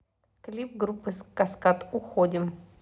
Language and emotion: Russian, neutral